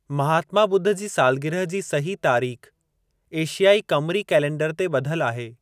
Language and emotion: Sindhi, neutral